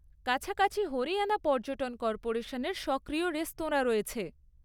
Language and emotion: Bengali, neutral